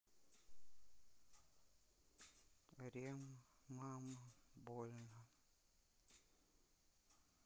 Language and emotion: Russian, neutral